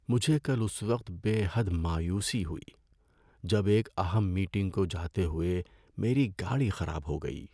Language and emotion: Urdu, sad